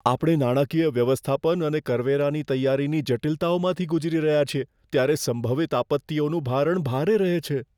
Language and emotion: Gujarati, fearful